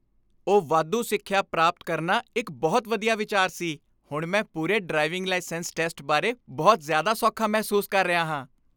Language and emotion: Punjabi, happy